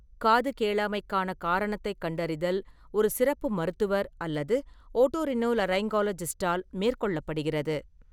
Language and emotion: Tamil, neutral